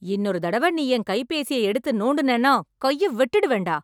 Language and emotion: Tamil, angry